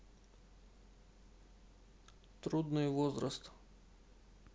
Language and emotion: Russian, neutral